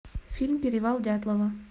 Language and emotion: Russian, neutral